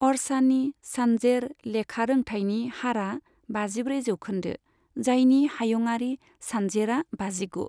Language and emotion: Bodo, neutral